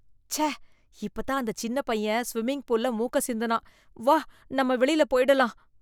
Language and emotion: Tamil, disgusted